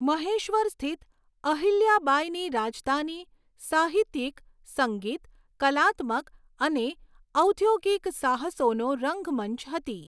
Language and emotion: Gujarati, neutral